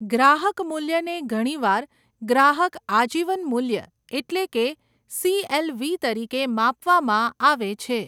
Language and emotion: Gujarati, neutral